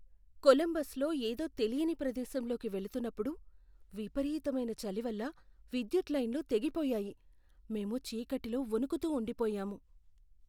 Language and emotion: Telugu, fearful